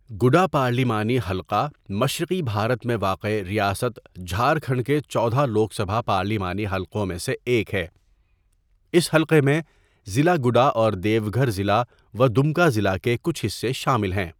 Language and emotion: Urdu, neutral